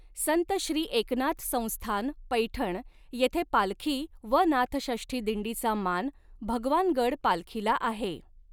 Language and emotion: Marathi, neutral